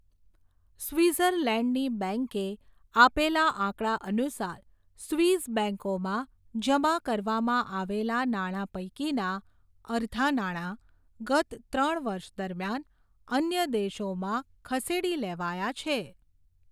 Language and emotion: Gujarati, neutral